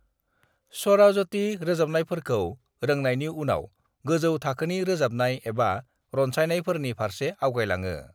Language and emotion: Bodo, neutral